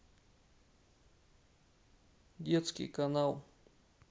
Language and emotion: Russian, neutral